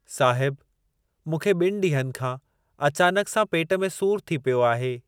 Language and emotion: Sindhi, neutral